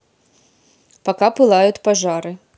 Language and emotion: Russian, neutral